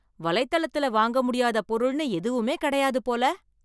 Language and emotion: Tamil, surprised